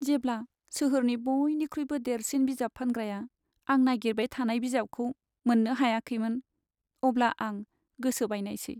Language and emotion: Bodo, sad